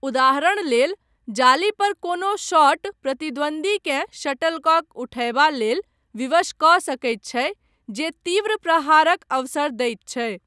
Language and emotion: Maithili, neutral